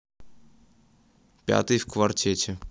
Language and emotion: Russian, neutral